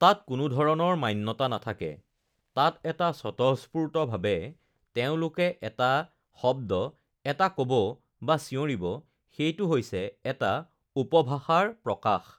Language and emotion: Assamese, neutral